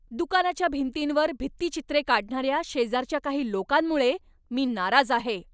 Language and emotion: Marathi, angry